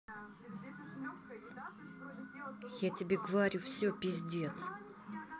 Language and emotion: Russian, neutral